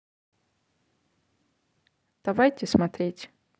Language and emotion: Russian, neutral